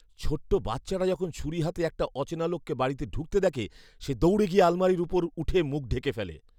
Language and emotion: Bengali, fearful